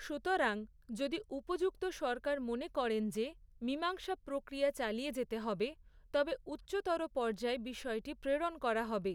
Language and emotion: Bengali, neutral